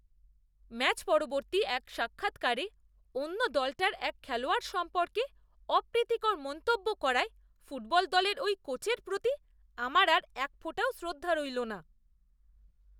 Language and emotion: Bengali, disgusted